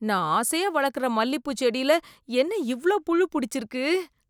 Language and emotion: Tamil, disgusted